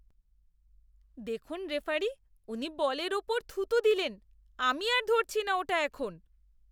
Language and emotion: Bengali, disgusted